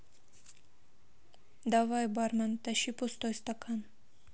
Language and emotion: Russian, neutral